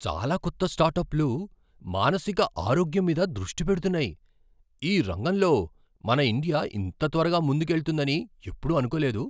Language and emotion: Telugu, surprised